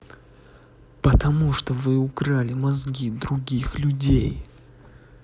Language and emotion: Russian, angry